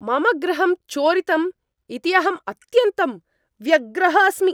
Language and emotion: Sanskrit, angry